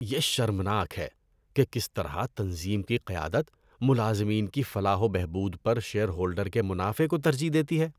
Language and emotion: Urdu, disgusted